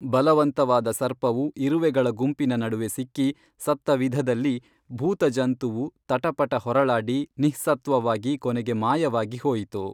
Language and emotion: Kannada, neutral